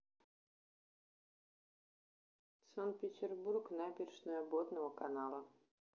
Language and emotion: Russian, neutral